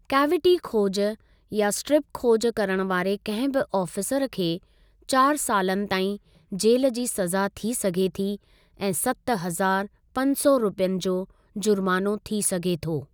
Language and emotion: Sindhi, neutral